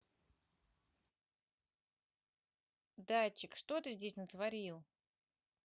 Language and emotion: Russian, neutral